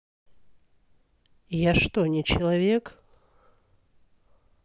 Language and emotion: Russian, angry